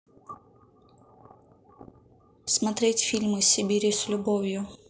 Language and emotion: Russian, neutral